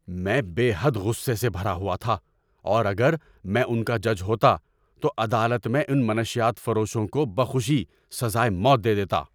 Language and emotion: Urdu, angry